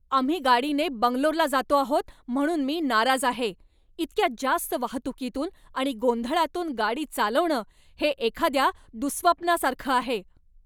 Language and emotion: Marathi, angry